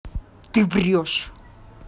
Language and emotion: Russian, angry